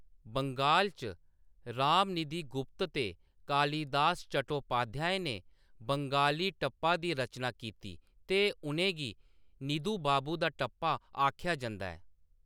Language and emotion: Dogri, neutral